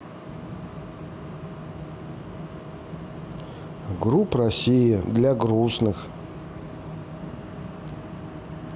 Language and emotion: Russian, sad